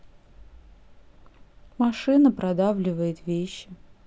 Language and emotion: Russian, sad